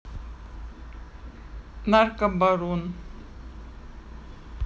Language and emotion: Russian, neutral